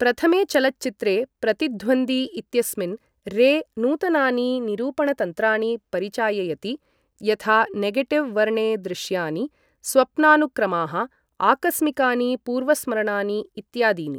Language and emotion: Sanskrit, neutral